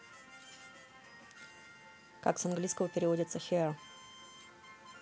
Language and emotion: Russian, neutral